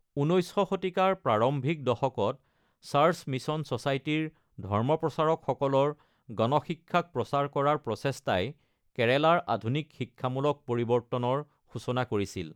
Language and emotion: Assamese, neutral